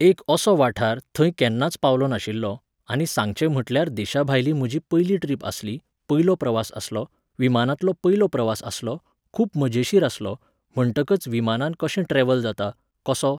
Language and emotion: Goan Konkani, neutral